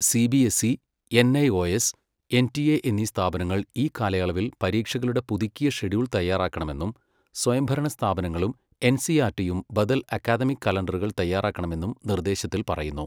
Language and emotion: Malayalam, neutral